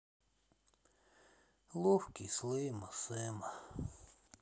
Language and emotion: Russian, sad